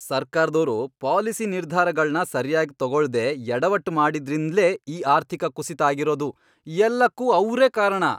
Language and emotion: Kannada, angry